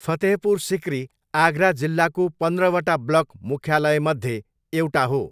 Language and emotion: Nepali, neutral